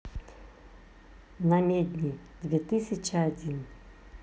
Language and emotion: Russian, neutral